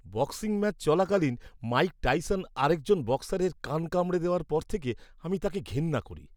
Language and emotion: Bengali, disgusted